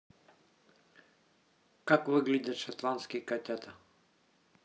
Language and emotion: Russian, neutral